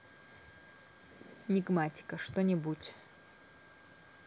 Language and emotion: Russian, neutral